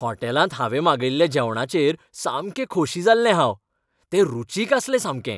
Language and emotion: Goan Konkani, happy